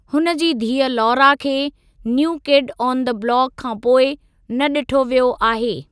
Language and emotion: Sindhi, neutral